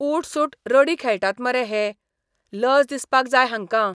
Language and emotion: Goan Konkani, disgusted